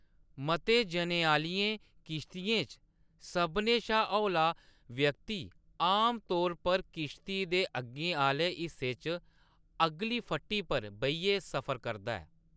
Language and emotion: Dogri, neutral